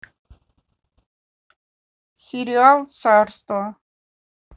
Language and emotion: Russian, neutral